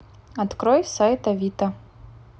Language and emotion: Russian, neutral